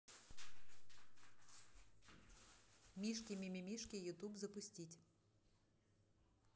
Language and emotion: Russian, neutral